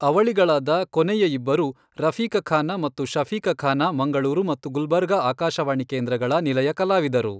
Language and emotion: Kannada, neutral